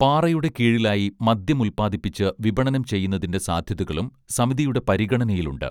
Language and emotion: Malayalam, neutral